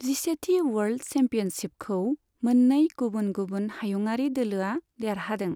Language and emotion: Bodo, neutral